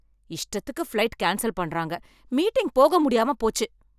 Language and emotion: Tamil, angry